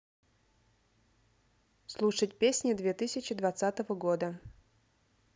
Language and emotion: Russian, neutral